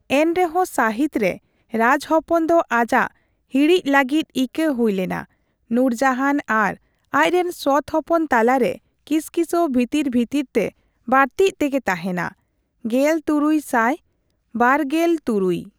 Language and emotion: Santali, neutral